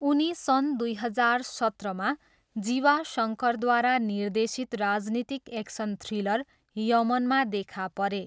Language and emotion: Nepali, neutral